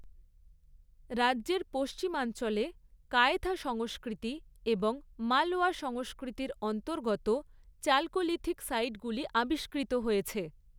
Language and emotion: Bengali, neutral